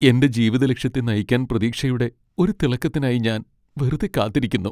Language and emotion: Malayalam, sad